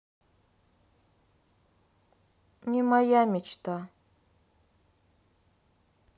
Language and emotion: Russian, sad